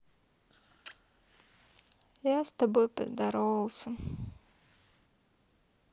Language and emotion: Russian, sad